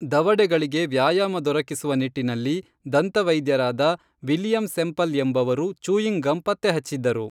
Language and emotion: Kannada, neutral